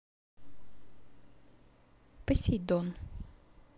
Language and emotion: Russian, neutral